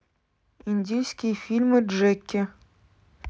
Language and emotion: Russian, neutral